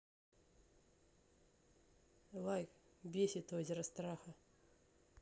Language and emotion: Russian, angry